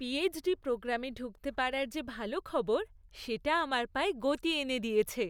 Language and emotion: Bengali, happy